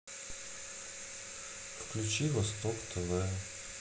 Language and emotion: Russian, sad